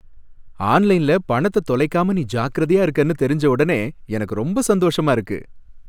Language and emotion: Tamil, happy